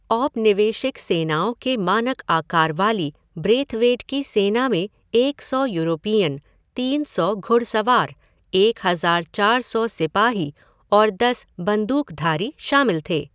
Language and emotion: Hindi, neutral